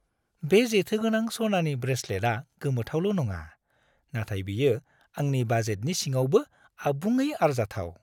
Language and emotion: Bodo, happy